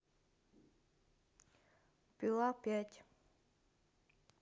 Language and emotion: Russian, neutral